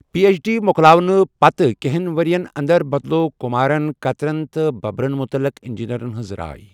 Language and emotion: Kashmiri, neutral